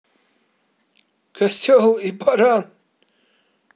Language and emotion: Russian, positive